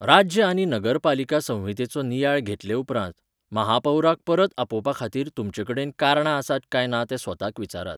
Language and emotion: Goan Konkani, neutral